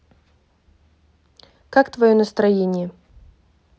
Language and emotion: Russian, neutral